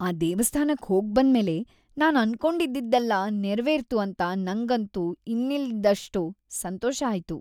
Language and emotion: Kannada, happy